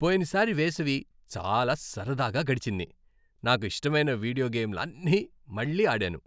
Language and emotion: Telugu, happy